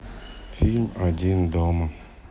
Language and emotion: Russian, sad